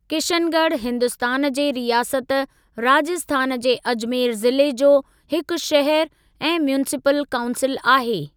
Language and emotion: Sindhi, neutral